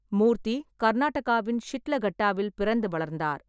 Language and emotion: Tamil, neutral